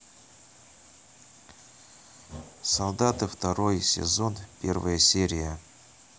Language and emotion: Russian, neutral